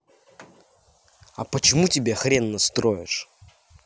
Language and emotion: Russian, angry